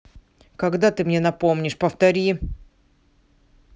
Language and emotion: Russian, angry